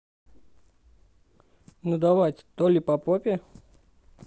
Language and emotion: Russian, neutral